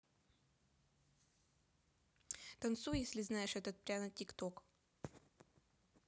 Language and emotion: Russian, neutral